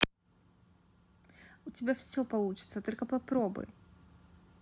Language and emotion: Russian, positive